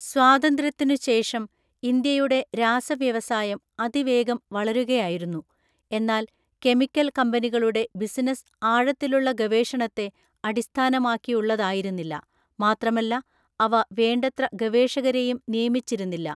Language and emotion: Malayalam, neutral